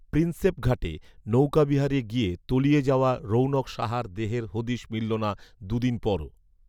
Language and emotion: Bengali, neutral